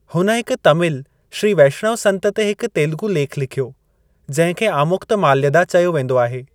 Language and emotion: Sindhi, neutral